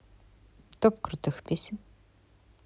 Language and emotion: Russian, neutral